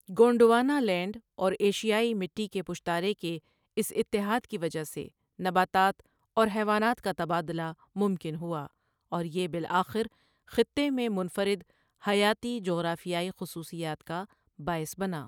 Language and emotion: Urdu, neutral